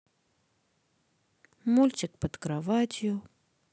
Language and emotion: Russian, sad